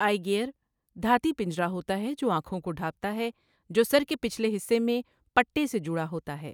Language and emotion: Urdu, neutral